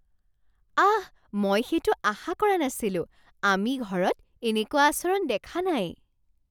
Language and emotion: Assamese, surprised